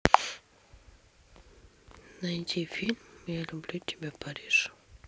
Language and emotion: Russian, neutral